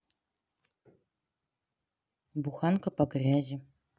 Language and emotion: Russian, neutral